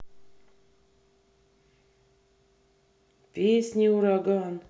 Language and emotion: Russian, neutral